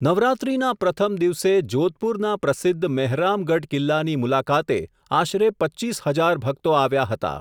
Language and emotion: Gujarati, neutral